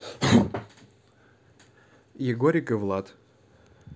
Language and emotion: Russian, neutral